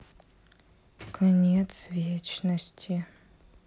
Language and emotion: Russian, sad